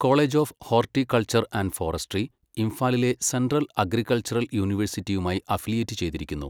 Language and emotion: Malayalam, neutral